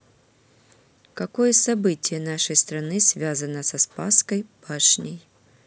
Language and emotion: Russian, neutral